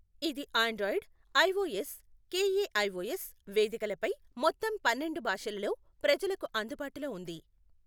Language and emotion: Telugu, neutral